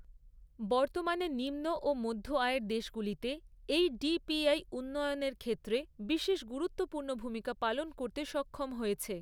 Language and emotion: Bengali, neutral